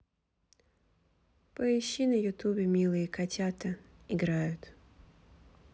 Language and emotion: Russian, neutral